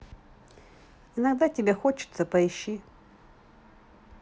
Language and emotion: Russian, neutral